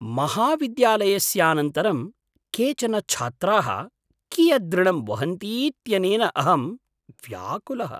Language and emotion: Sanskrit, surprised